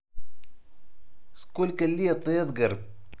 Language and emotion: Russian, positive